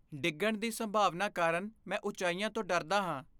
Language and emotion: Punjabi, fearful